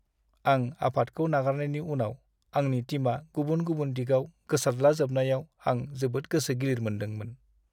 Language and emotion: Bodo, sad